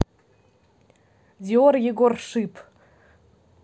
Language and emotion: Russian, neutral